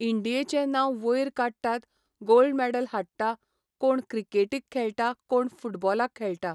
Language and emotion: Goan Konkani, neutral